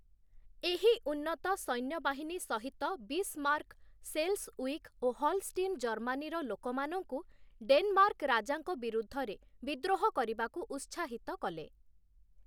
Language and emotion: Odia, neutral